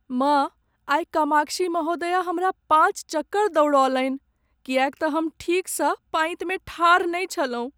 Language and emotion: Maithili, sad